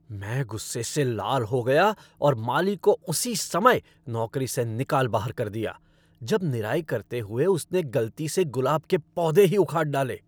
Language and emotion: Hindi, angry